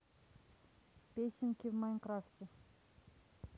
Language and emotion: Russian, neutral